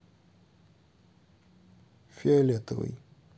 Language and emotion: Russian, neutral